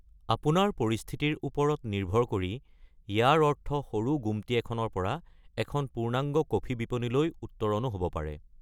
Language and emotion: Assamese, neutral